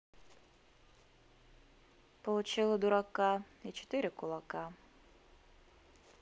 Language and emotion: Russian, neutral